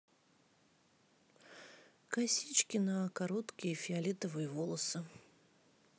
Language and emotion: Russian, neutral